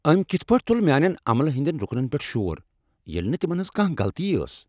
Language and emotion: Kashmiri, angry